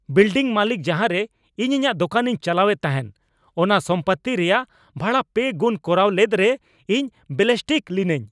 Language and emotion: Santali, angry